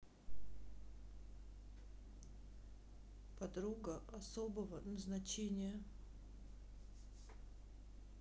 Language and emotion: Russian, sad